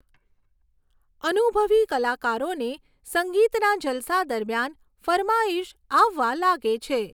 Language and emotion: Gujarati, neutral